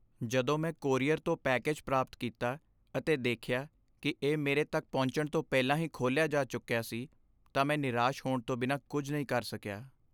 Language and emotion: Punjabi, sad